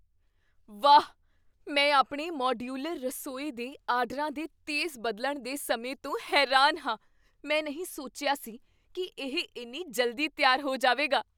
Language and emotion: Punjabi, surprised